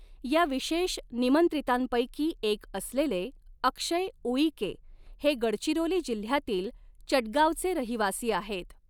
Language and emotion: Marathi, neutral